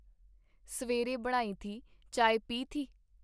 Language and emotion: Punjabi, neutral